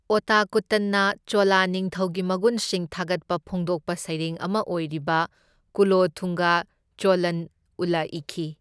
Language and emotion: Manipuri, neutral